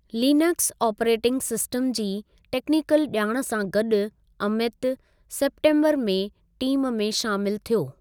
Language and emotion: Sindhi, neutral